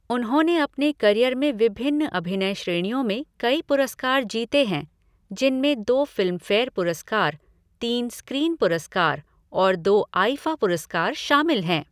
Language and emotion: Hindi, neutral